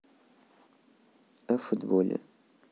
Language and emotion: Russian, neutral